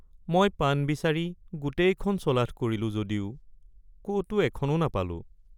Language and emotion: Assamese, sad